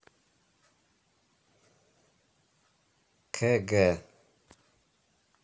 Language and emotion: Russian, neutral